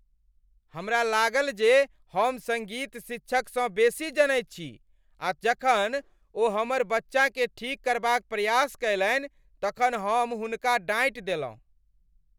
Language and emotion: Maithili, angry